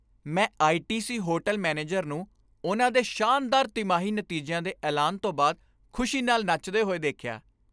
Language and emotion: Punjabi, happy